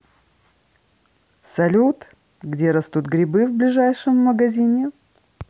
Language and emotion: Russian, positive